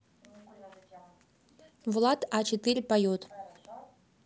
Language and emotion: Russian, neutral